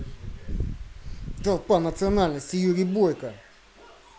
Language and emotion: Russian, angry